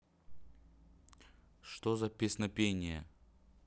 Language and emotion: Russian, neutral